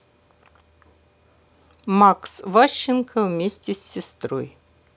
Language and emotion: Russian, neutral